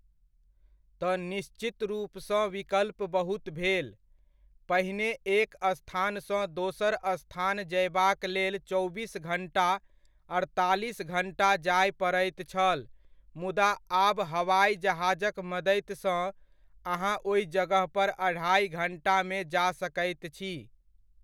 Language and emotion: Maithili, neutral